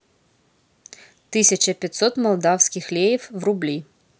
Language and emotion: Russian, neutral